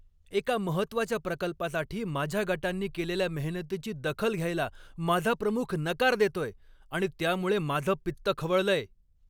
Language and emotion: Marathi, angry